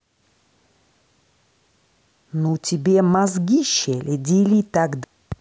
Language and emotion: Russian, angry